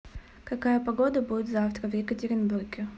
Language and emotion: Russian, neutral